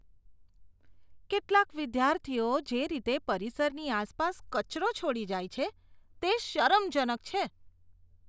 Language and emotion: Gujarati, disgusted